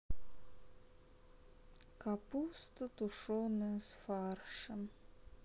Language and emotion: Russian, sad